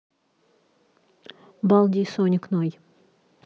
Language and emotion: Russian, neutral